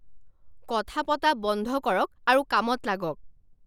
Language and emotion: Assamese, angry